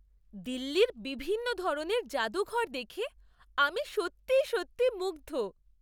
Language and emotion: Bengali, surprised